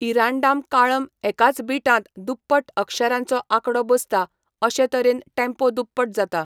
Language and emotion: Goan Konkani, neutral